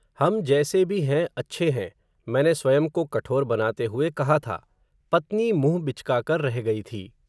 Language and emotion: Hindi, neutral